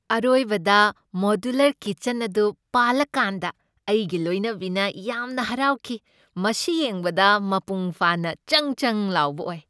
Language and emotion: Manipuri, happy